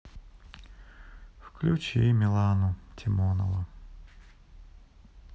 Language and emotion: Russian, sad